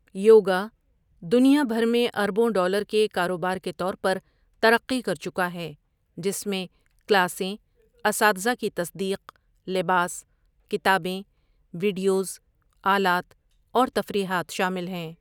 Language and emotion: Urdu, neutral